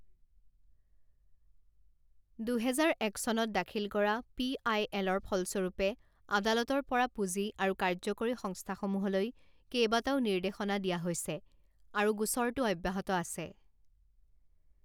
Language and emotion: Assamese, neutral